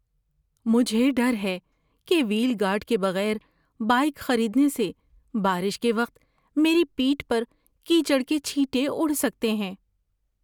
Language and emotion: Urdu, fearful